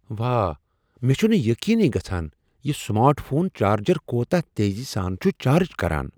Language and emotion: Kashmiri, surprised